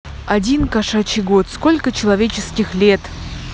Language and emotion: Russian, positive